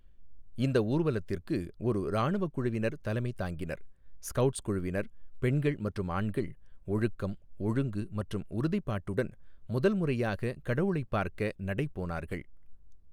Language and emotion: Tamil, neutral